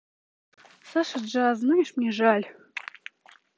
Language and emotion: Russian, neutral